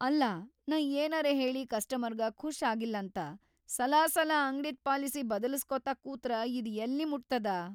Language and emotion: Kannada, fearful